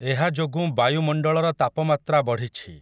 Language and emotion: Odia, neutral